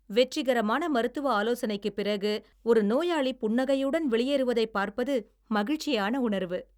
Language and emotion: Tamil, happy